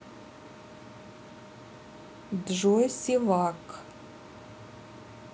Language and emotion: Russian, neutral